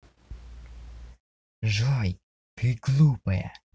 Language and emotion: Russian, neutral